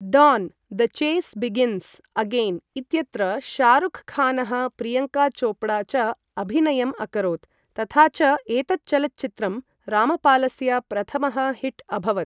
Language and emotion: Sanskrit, neutral